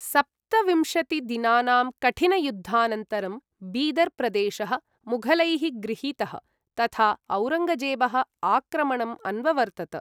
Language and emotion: Sanskrit, neutral